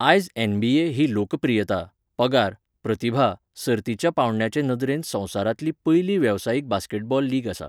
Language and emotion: Goan Konkani, neutral